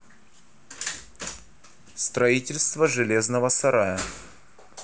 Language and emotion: Russian, neutral